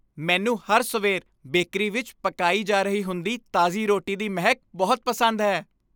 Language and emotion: Punjabi, happy